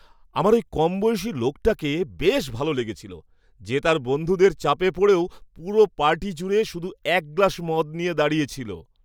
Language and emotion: Bengali, happy